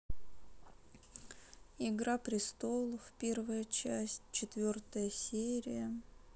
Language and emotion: Russian, sad